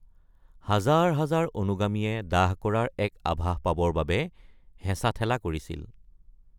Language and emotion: Assamese, neutral